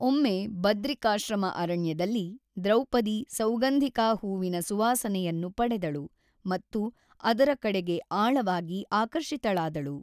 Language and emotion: Kannada, neutral